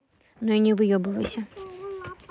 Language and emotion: Russian, neutral